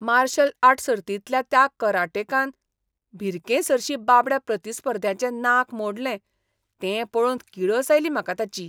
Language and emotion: Goan Konkani, disgusted